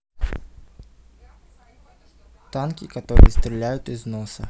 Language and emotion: Russian, neutral